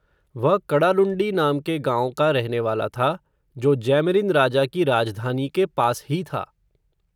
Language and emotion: Hindi, neutral